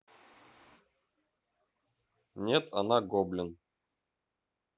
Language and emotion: Russian, neutral